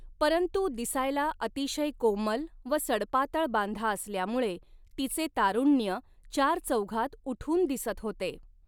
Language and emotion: Marathi, neutral